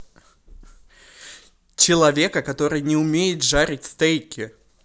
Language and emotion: Russian, neutral